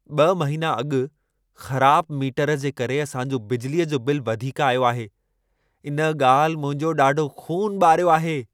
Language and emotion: Sindhi, angry